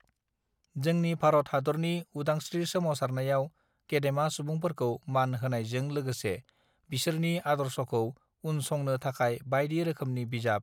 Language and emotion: Bodo, neutral